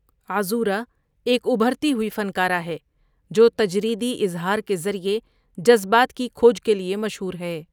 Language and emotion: Urdu, neutral